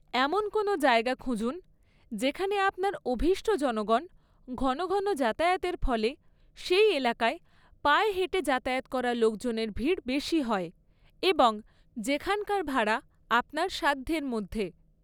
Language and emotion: Bengali, neutral